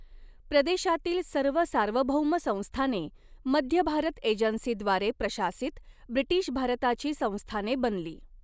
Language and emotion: Marathi, neutral